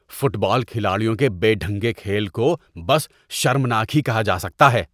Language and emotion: Urdu, disgusted